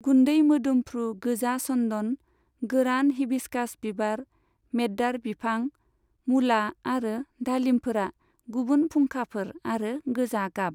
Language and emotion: Bodo, neutral